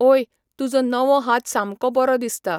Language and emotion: Goan Konkani, neutral